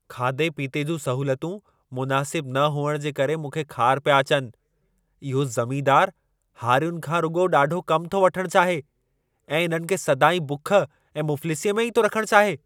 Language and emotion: Sindhi, angry